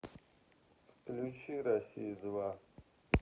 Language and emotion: Russian, neutral